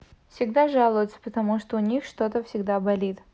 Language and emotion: Russian, neutral